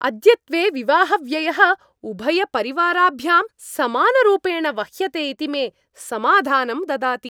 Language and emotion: Sanskrit, happy